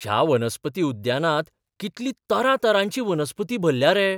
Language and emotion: Goan Konkani, surprised